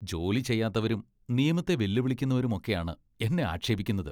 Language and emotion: Malayalam, disgusted